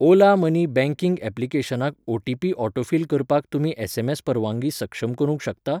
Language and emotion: Goan Konkani, neutral